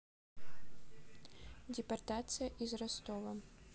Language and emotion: Russian, neutral